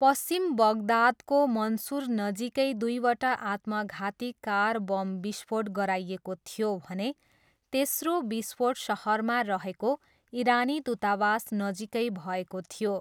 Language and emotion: Nepali, neutral